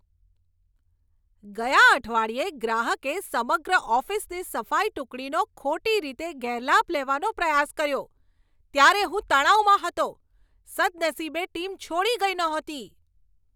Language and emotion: Gujarati, angry